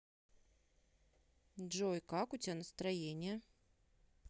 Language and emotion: Russian, neutral